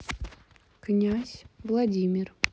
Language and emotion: Russian, neutral